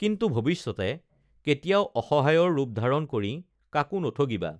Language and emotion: Assamese, neutral